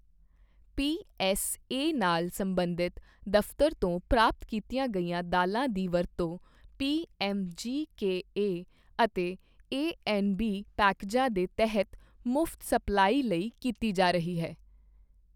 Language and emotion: Punjabi, neutral